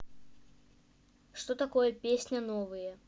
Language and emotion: Russian, neutral